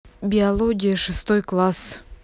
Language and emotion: Russian, neutral